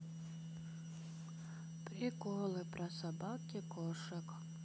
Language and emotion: Russian, sad